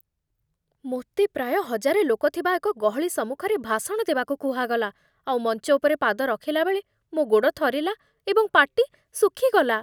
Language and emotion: Odia, fearful